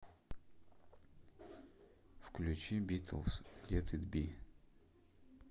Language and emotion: Russian, neutral